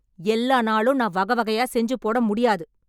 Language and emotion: Tamil, angry